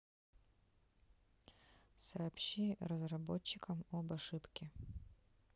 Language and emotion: Russian, neutral